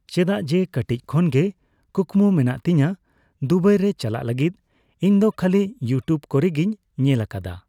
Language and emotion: Santali, neutral